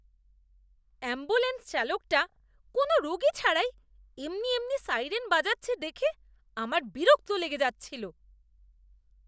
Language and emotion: Bengali, disgusted